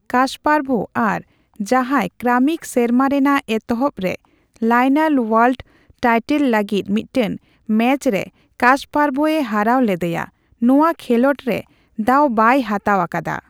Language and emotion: Santali, neutral